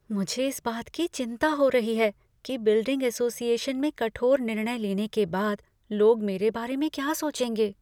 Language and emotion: Hindi, fearful